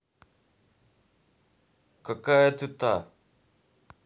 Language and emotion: Russian, angry